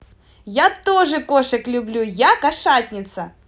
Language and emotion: Russian, positive